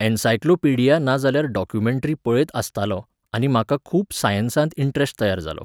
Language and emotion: Goan Konkani, neutral